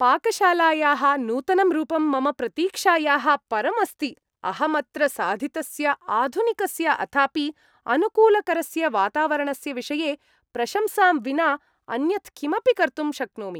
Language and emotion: Sanskrit, happy